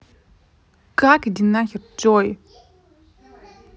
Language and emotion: Russian, angry